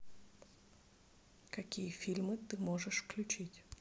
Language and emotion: Russian, neutral